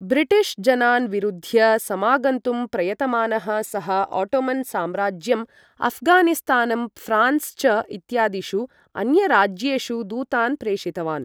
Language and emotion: Sanskrit, neutral